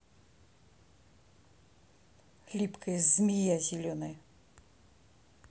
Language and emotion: Russian, angry